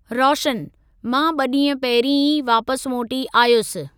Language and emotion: Sindhi, neutral